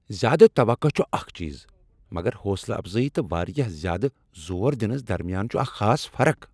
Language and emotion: Kashmiri, angry